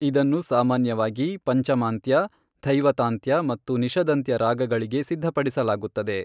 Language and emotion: Kannada, neutral